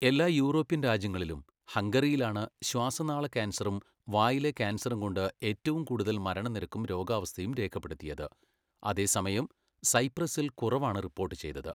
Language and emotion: Malayalam, neutral